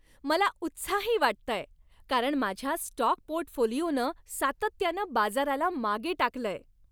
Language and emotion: Marathi, happy